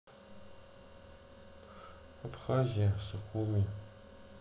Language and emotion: Russian, neutral